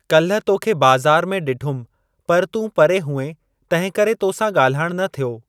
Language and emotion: Sindhi, neutral